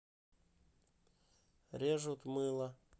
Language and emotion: Russian, neutral